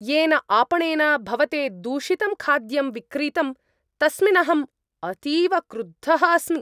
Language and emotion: Sanskrit, angry